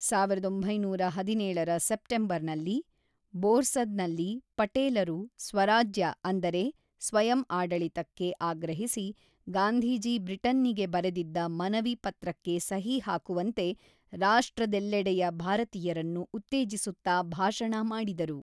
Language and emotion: Kannada, neutral